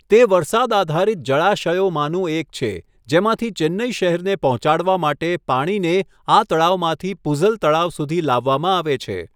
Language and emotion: Gujarati, neutral